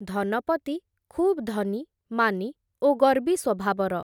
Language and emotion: Odia, neutral